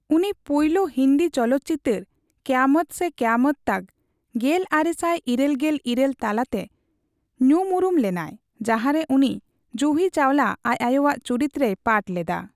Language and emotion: Santali, neutral